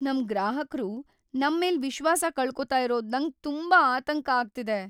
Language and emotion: Kannada, fearful